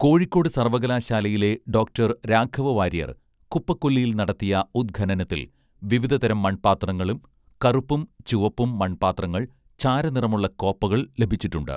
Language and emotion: Malayalam, neutral